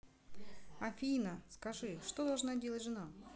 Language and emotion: Russian, neutral